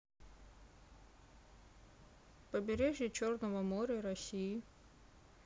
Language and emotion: Russian, neutral